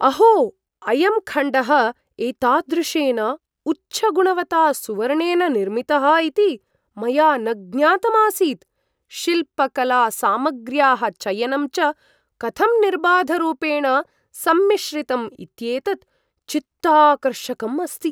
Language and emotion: Sanskrit, surprised